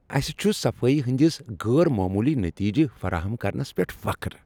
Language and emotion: Kashmiri, happy